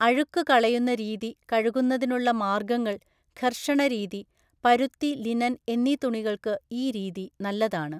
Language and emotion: Malayalam, neutral